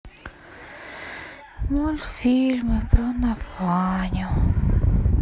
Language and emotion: Russian, sad